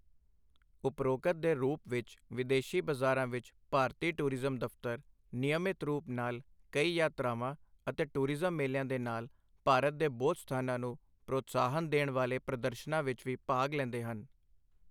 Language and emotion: Punjabi, neutral